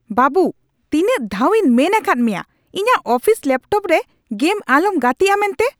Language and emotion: Santali, angry